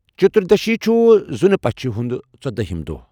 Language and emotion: Kashmiri, neutral